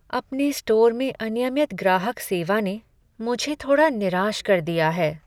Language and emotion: Hindi, sad